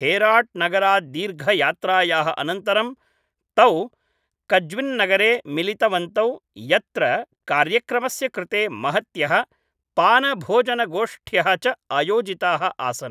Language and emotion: Sanskrit, neutral